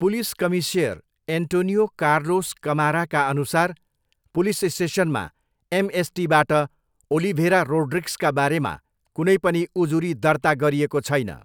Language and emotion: Nepali, neutral